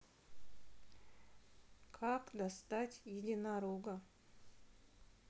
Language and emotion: Russian, sad